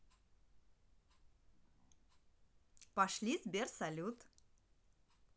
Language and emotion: Russian, positive